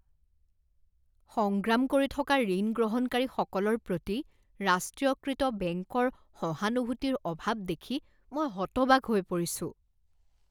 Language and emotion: Assamese, disgusted